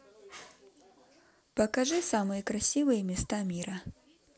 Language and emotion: Russian, positive